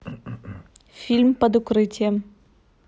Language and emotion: Russian, neutral